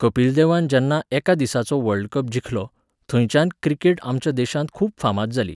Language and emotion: Goan Konkani, neutral